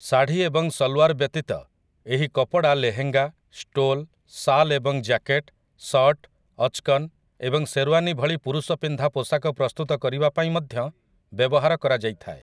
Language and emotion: Odia, neutral